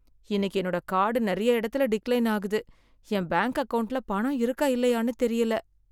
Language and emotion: Tamil, sad